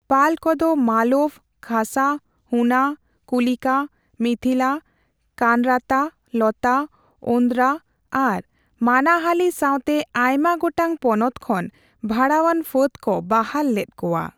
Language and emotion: Santali, neutral